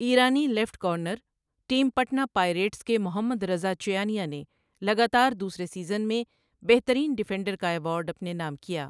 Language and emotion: Urdu, neutral